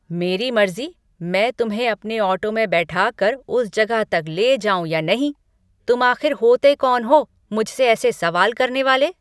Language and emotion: Hindi, angry